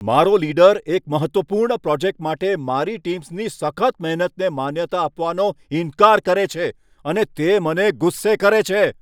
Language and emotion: Gujarati, angry